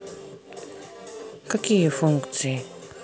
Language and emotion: Russian, neutral